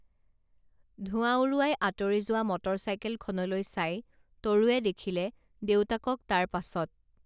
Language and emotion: Assamese, neutral